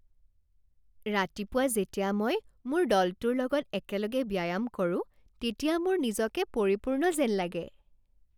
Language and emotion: Assamese, happy